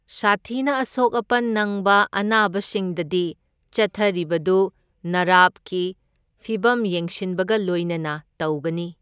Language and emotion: Manipuri, neutral